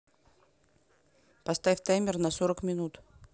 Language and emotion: Russian, neutral